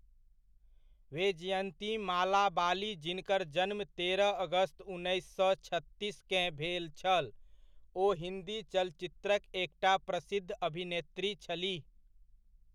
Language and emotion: Maithili, neutral